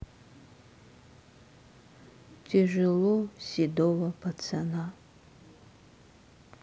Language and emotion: Russian, sad